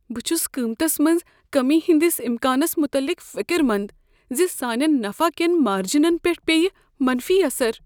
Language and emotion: Kashmiri, fearful